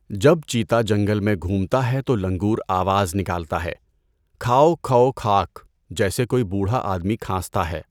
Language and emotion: Urdu, neutral